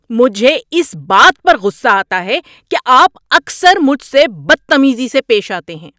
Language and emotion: Urdu, angry